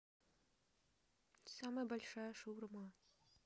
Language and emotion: Russian, neutral